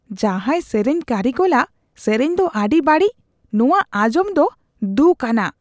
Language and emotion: Santali, disgusted